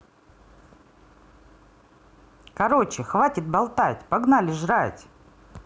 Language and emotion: Russian, positive